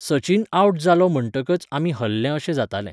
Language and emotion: Goan Konkani, neutral